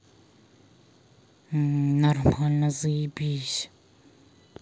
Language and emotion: Russian, neutral